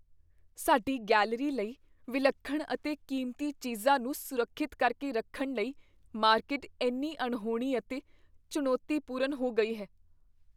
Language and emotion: Punjabi, fearful